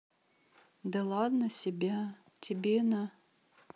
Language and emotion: Russian, neutral